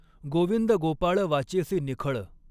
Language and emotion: Marathi, neutral